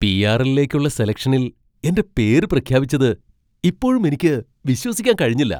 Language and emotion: Malayalam, surprised